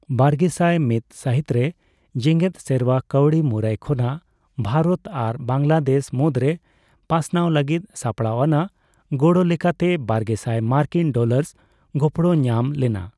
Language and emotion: Santali, neutral